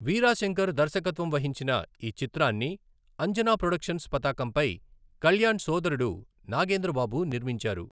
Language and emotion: Telugu, neutral